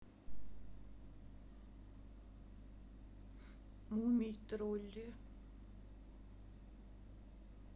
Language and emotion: Russian, sad